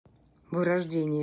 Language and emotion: Russian, neutral